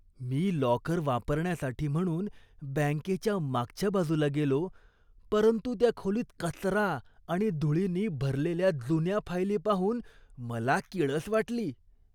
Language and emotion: Marathi, disgusted